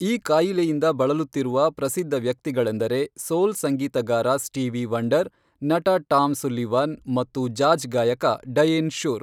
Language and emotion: Kannada, neutral